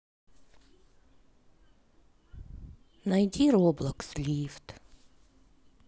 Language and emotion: Russian, sad